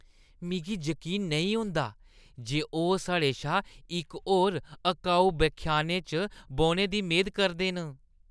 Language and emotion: Dogri, disgusted